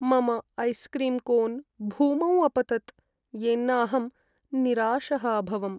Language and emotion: Sanskrit, sad